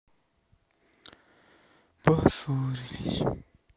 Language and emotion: Russian, sad